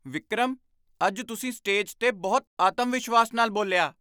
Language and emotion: Punjabi, surprised